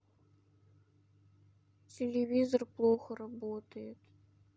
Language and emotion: Russian, sad